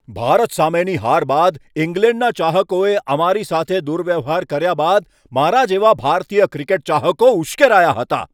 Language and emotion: Gujarati, angry